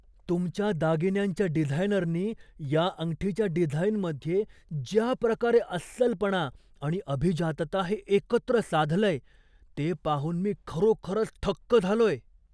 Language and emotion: Marathi, surprised